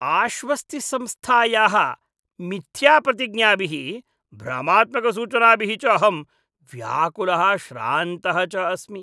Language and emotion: Sanskrit, disgusted